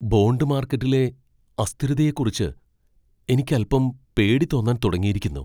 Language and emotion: Malayalam, fearful